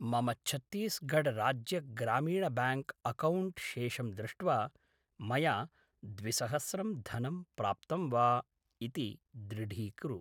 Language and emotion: Sanskrit, neutral